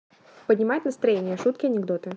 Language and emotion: Russian, neutral